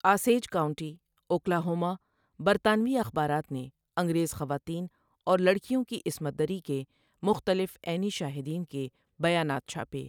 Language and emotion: Urdu, neutral